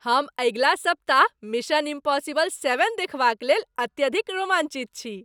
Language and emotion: Maithili, happy